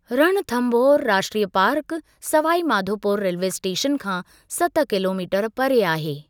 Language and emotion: Sindhi, neutral